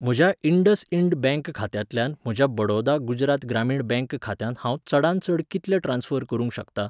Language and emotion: Goan Konkani, neutral